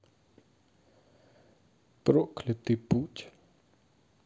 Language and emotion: Russian, sad